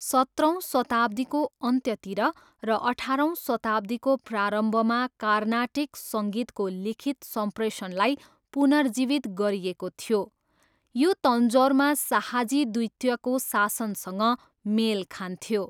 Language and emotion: Nepali, neutral